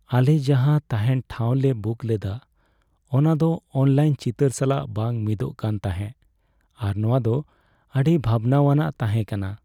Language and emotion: Santali, sad